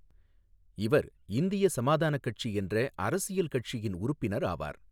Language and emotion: Tamil, neutral